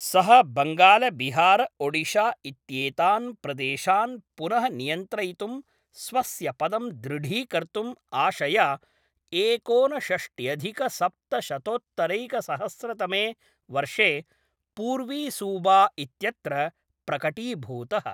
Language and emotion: Sanskrit, neutral